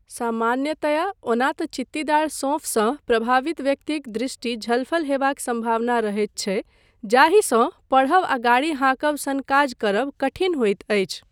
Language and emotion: Maithili, neutral